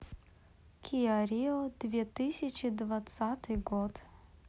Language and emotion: Russian, neutral